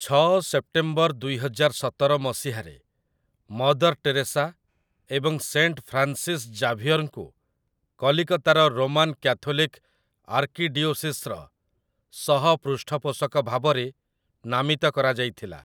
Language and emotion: Odia, neutral